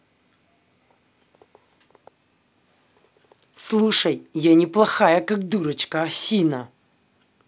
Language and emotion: Russian, angry